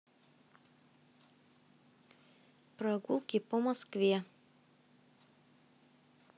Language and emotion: Russian, neutral